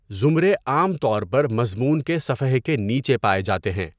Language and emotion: Urdu, neutral